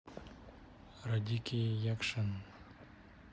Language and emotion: Russian, neutral